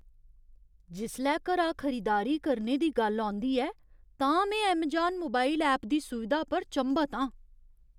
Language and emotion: Dogri, surprised